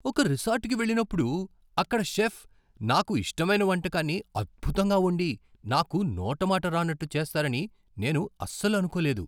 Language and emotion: Telugu, surprised